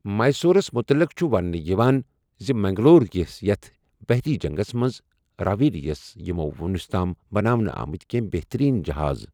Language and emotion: Kashmiri, neutral